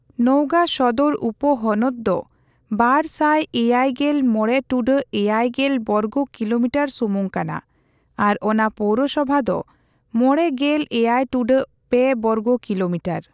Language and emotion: Santali, neutral